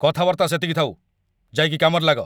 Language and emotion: Odia, angry